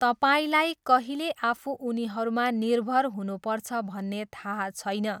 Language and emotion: Nepali, neutral